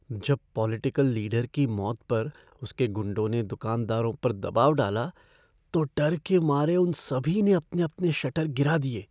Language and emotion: Hindi, fearful